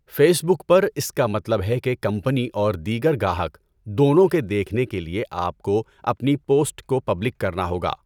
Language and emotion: Urdu, neutral